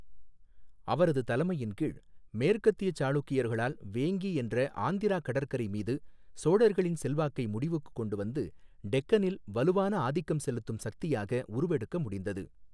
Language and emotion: Tamil, neutral